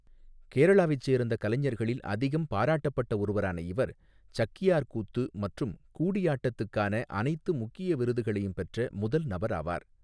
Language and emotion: Tamil, neutral